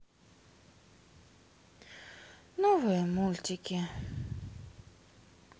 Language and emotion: Russian, sad